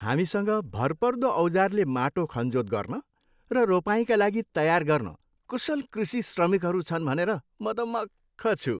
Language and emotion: Nepali, happy